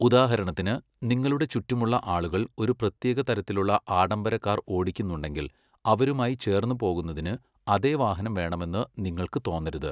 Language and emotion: Malayalam, neutral